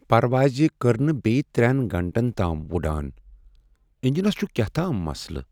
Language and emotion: Kashmiri, sad